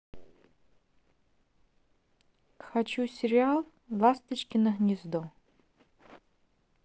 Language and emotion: Russian, neutral